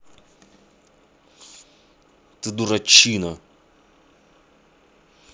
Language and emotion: Russian, angry